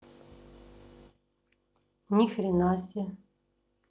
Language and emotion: Russian, neutral